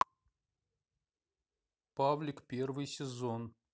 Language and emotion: Russian, neutral